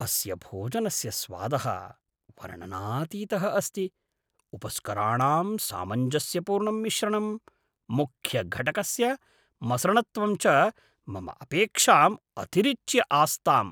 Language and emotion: Sanskrit, surprised